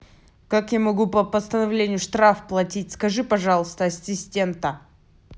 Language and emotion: Russian, angry